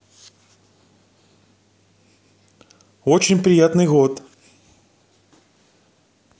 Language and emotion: Russian, neutral